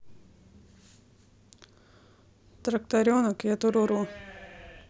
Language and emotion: Russian, neutral